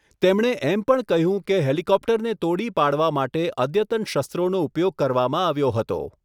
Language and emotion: Gujarati, neutral